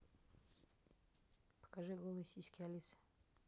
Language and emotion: Russian, neutral